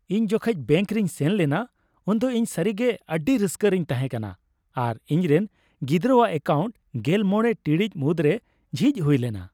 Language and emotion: Santali, happy